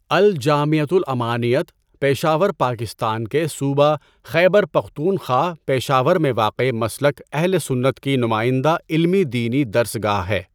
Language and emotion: Urdu, neutral